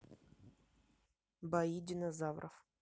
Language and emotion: Russian, neutral